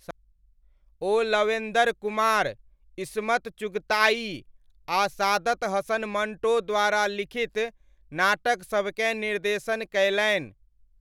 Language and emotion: Maithili, neutral